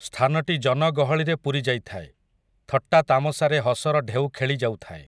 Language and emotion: Odia, neutral